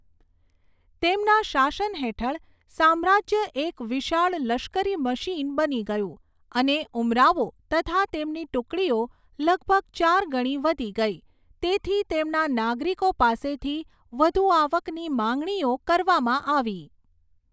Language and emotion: Gujarati, neutral